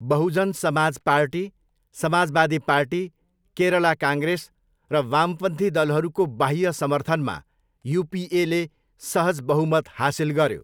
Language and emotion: Nepali, neutral